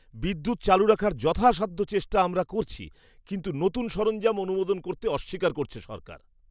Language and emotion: Bengali, disgusted